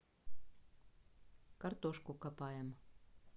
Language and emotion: Russian, neutral